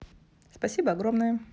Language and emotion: Russian, positive